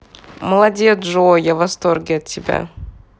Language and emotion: Russian, positive